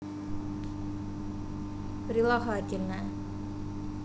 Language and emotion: Russian, neutral